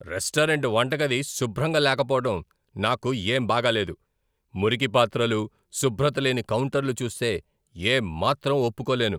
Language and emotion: Telugu, angry